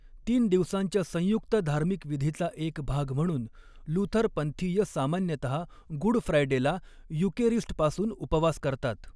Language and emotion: Marathi, neutral